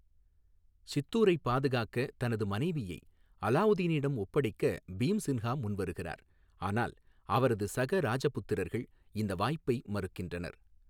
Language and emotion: Tamil, neutral